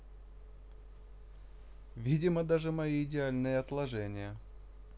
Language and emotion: Russian, neutral